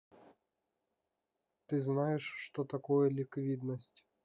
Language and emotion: Russian, neutral